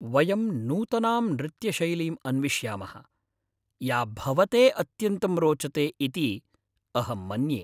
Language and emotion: Sanskrit, happy